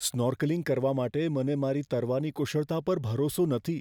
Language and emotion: Gujarati, fearful